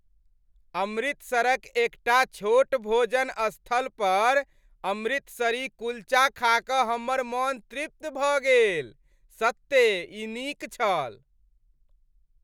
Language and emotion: Maithili, happy